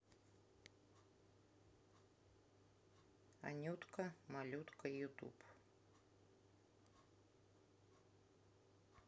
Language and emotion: Russian, neutral